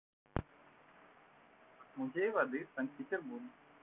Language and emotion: Russian, neutral